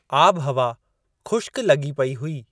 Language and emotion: Sindhi, neutral